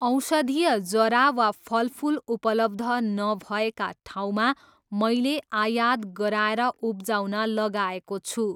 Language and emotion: Nepali, neutral